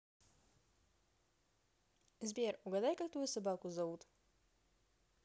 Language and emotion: Russian, positive